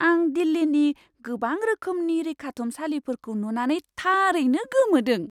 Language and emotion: Bodo, surprised